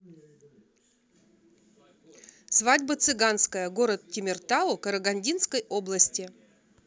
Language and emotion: Russian, neutral